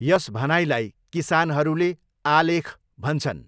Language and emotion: Nepali, neutral